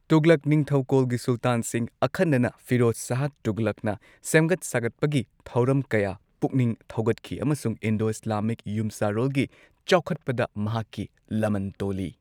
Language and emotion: Manipuri, neutral